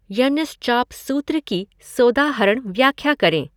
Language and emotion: Hindi, neutral